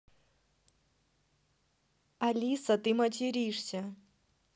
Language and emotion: Russian, neutral